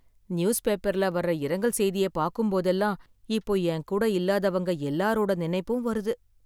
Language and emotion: Tamil, sad